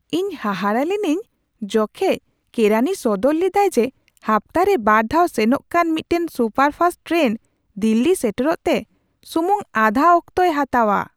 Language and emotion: Santali, surprised